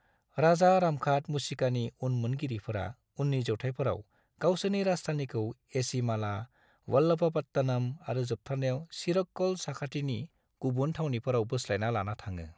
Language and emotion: Bodo, neutral